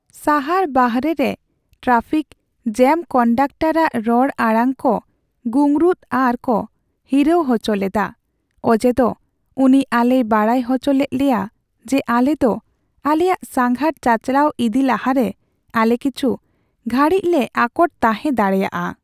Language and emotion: Santali, sad